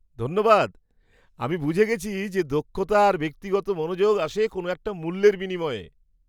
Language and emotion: Bengali, surprised